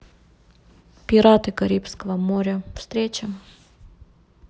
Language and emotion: Russian, neutral